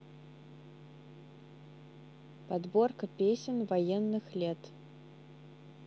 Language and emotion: Russian, neutral